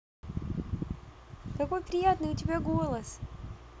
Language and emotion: Russian, positive